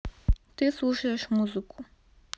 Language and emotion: Russian, neutral